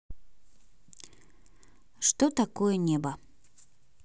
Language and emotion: Russian, neutral